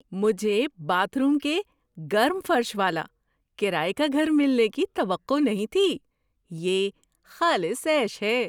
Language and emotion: Urdu, surprised